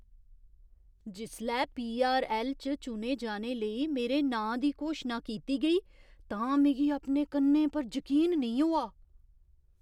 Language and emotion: Dogri, surprised